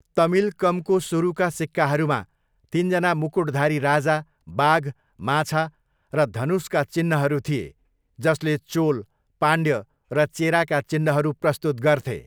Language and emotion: Nepali, neutral